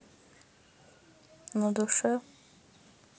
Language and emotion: Russian, sad